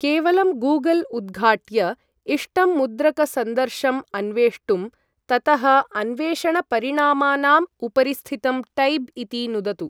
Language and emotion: Sanskrit, neutral